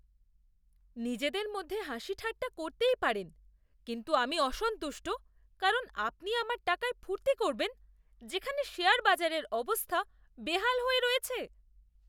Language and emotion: Bengali, disgusted